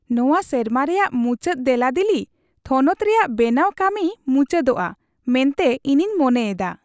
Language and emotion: Santali, happy